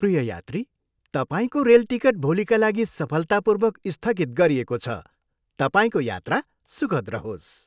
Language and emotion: Nepali, happy